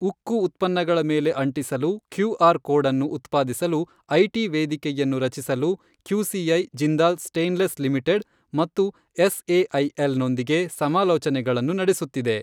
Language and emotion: Kannada, neutral